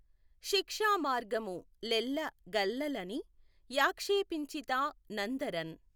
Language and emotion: Telugu, neutral